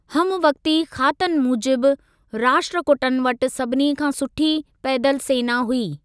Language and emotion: Sindhi, neutral